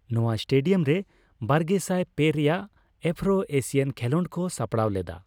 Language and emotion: Santali, neutral